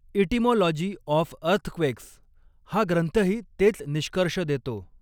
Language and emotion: Marathi, neutral